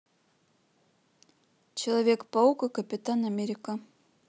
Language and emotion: Russian, neutral